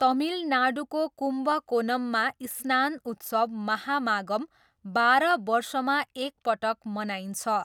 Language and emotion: Nepali, neutral